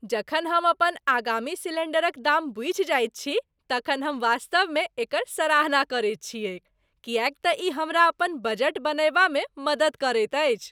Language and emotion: Maithili, happy